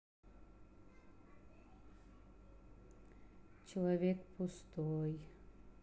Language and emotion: Russian, neutral